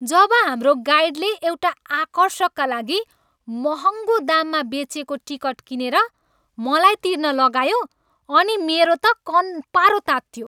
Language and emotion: Nepali, angry